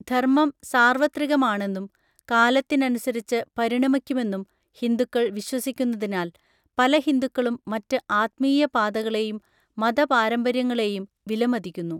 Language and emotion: Malayalam, neutral